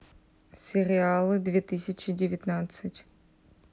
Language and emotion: Russian, neutral